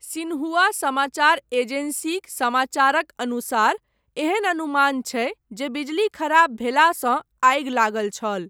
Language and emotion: Maithili, neutral